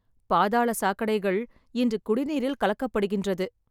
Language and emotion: Tamil, sad